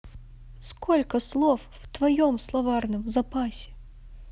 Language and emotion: Russian, sad